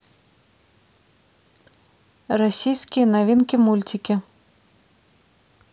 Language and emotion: Russian, neutral